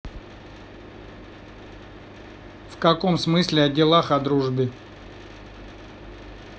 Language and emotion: Russian, neutral